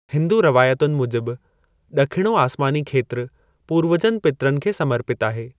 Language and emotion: Sindhi, neutral